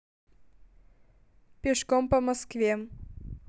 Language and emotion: Russian, neutral